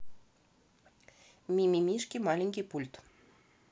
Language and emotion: Russian, neutral